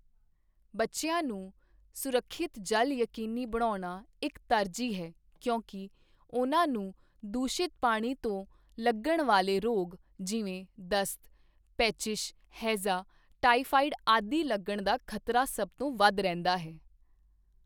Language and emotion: Punjabi, neutral